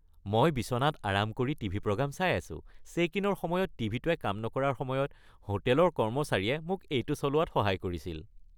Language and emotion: Assamese, happy